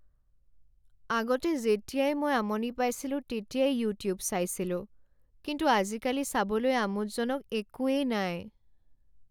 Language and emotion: Assamese, sad